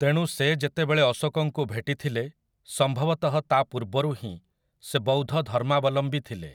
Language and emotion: Odia, neutral